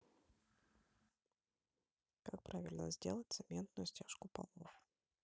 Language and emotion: Russian, neutral